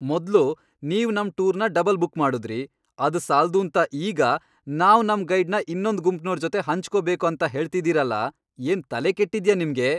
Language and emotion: Kannada, angry